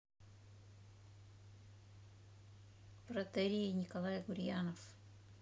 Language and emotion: Russian, neutral